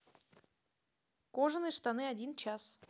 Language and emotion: Russian, neutral